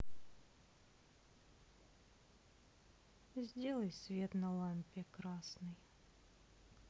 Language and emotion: Russian, sad